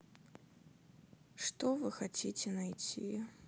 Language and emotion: Russian, sad